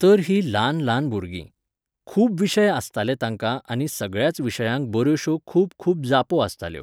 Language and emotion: Goan Konkani, neutral